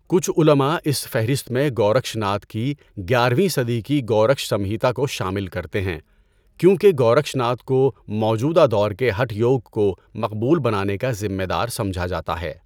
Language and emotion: Urdu, neutral